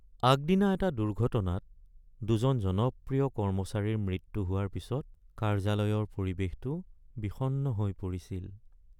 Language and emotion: Assamese, sad